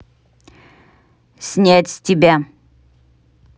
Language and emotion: Russian, neutral